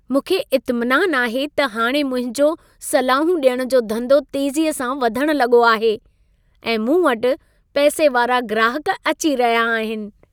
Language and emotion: Sindhi, happy